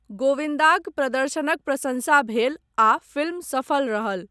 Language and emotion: Maithili, neutral